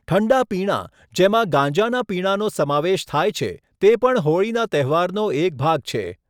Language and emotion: Gujarati, neutral